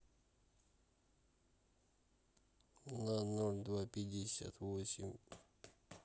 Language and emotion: Russian, neutral